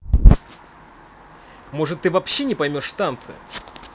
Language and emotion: Russian, angry